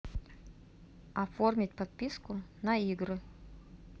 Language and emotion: Russian, neutral